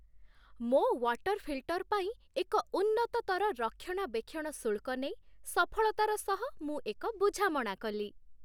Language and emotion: Odia, happy